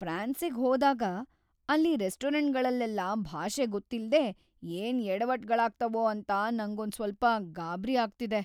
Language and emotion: Kannada, fearful